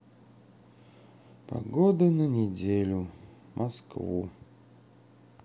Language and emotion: Russian, sad